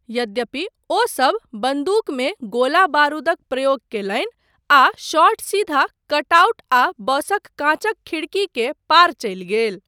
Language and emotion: Maithili, neutral